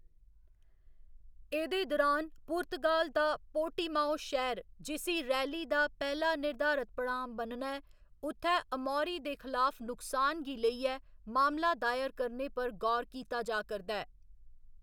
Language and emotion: Dogri, neutral